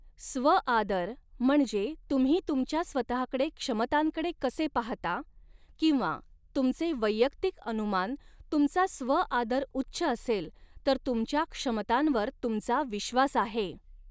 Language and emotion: Marathi, neutral